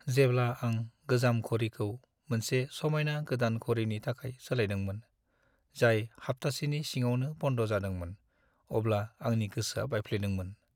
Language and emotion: Bodo, sad